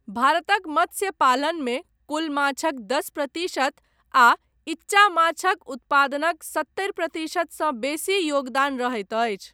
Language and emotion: Maithili, neutral